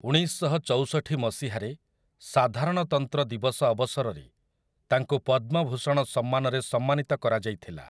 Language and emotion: Odia, neutral